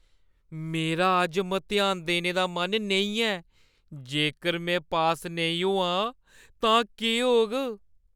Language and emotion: Dogri, fearful